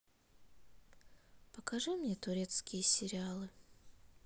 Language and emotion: Russian, sad